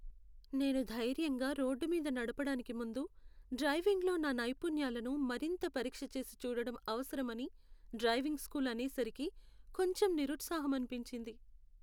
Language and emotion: Telugu, sad